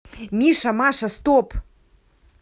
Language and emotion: Russian, angry